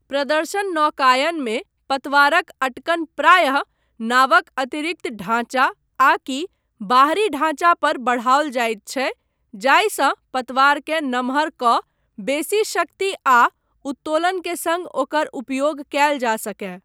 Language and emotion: Maithili, neutral